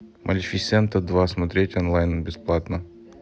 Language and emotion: Russian, neutral